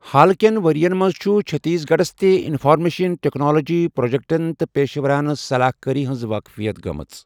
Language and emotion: Kashmiri, neutral